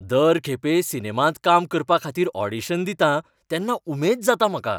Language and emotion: Goan Konkani, happy